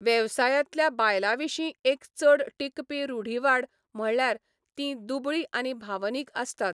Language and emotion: Goan Konkani, neutral